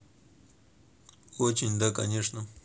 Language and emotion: Russian, neutral